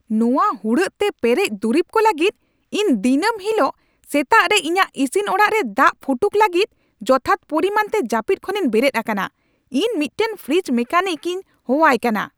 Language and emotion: Santali, angry